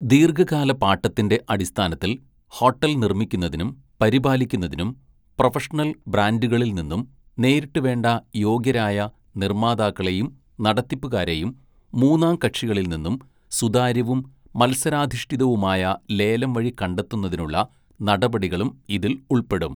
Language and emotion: Malayalam, neutral